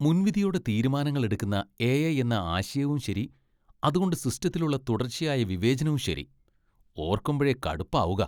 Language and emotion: Malayalam, disgusted